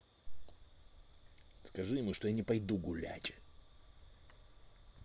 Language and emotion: Russian, angry